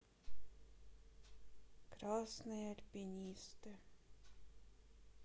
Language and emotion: Russian, sad